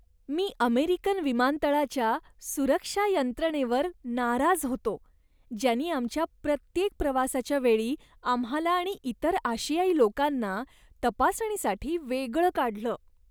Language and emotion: Marathi, disgusted